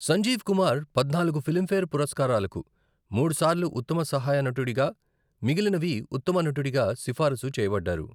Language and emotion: Telugu, neutral